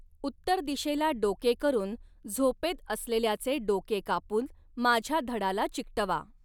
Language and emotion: Marathi, neutral